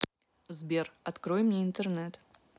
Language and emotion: Russian, neutral